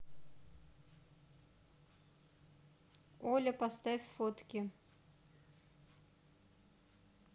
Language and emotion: Russian, neutral